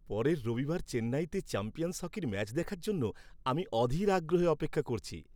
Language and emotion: Bengali, happy